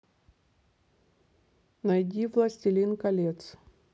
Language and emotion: Russian, neutral